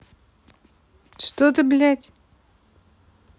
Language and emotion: Russian, angry